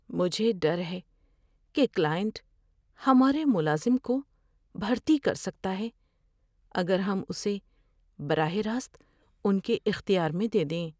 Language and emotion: Urdu, fearful